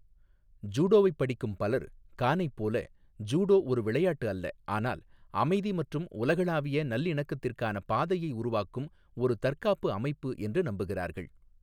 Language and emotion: Tamil, neutral